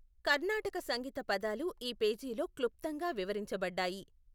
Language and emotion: Telugu, neutral